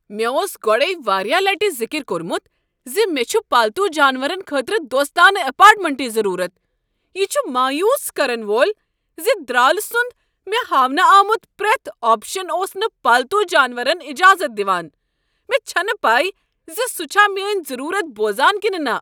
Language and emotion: Kashmiri, angry